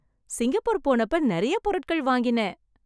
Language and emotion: Tamil, happy